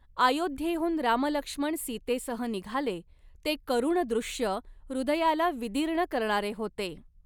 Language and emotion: Marathi, neutral